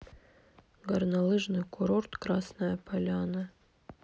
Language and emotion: Russian, neutral